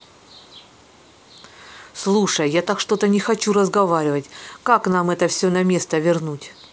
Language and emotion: Russian, neutral